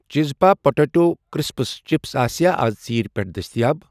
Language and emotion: Kashmiri, neutral